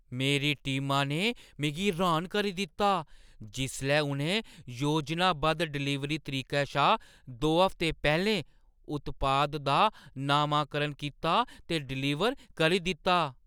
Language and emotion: Dogri, surprised